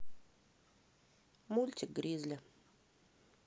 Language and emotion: Russian, neutral